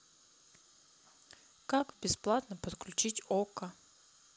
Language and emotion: Russian, sad